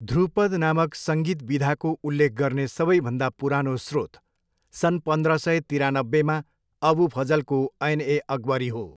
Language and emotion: Nepali, neutral